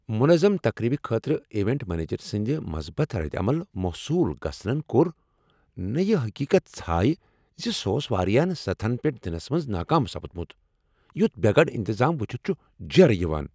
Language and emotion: Kashmiri, angry